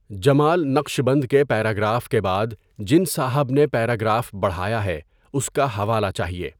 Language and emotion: Urdu, neutral